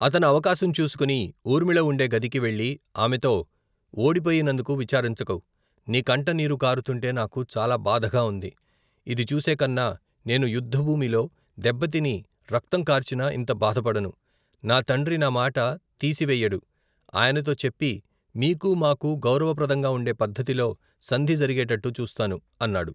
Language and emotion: Telugu, neutral